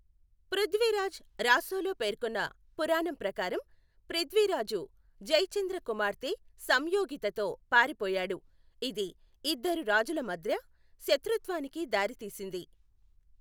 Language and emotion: Telugu, neutral